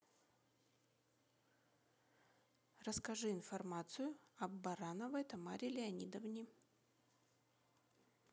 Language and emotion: Russian, neutral